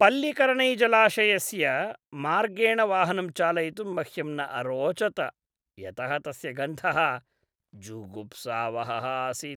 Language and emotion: Sanskrit, disgusted